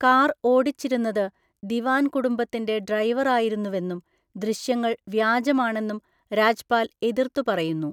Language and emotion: Malayalam, neutral